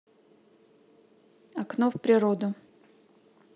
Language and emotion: Russian, neutral